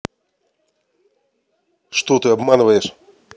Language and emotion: Russian, angry